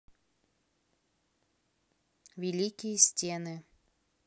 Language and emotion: Russian, neutral